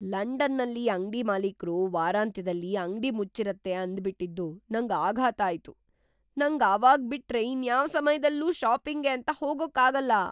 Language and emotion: Kannada, surprised